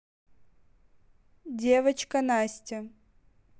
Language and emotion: Russian, neutral